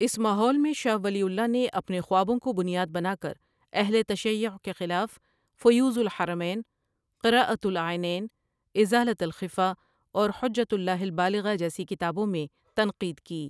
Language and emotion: Urdu, neutral